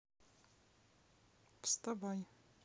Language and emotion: Russian, neutral